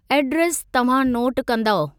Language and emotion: Sindhi, neutral